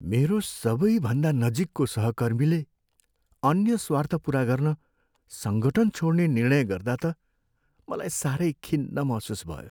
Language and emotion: Nepali, sad